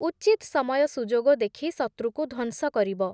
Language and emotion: Odia, neutral